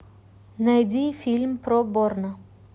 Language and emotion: Russian, neutral